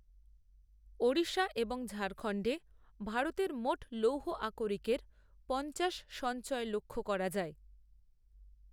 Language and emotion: Bengali, neutral